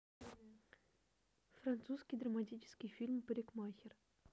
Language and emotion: Russian, neutral